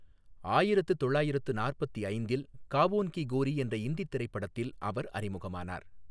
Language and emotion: Tamil, neutral